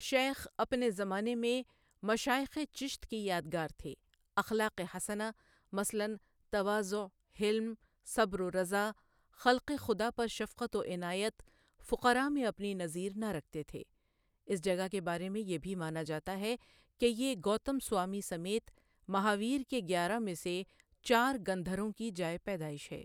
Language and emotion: Urdu, neutral